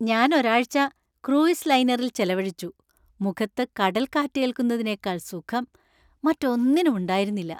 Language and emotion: Malayalam, happy